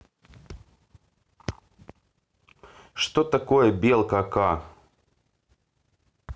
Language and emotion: Russian, neutral